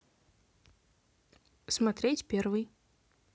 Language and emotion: Russian, neutral